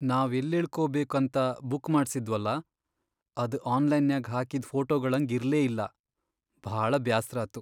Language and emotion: Kannada, sad